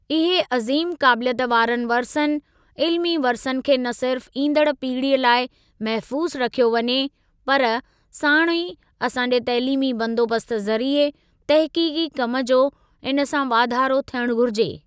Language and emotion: Sindhi, neutral